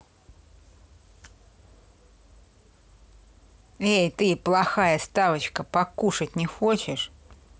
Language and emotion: Russian, angry